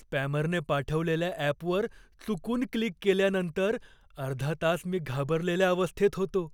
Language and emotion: Marathi, fearful